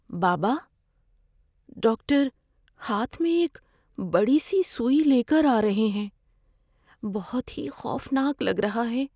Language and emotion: Urdu, fearful